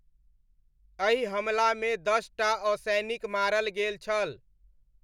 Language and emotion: Maithili, neutral